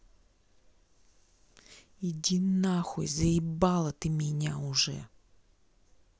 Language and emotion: Russian, angry